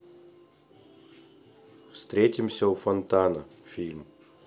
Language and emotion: Russian, neutral